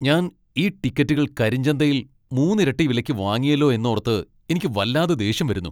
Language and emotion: Malayalam, angry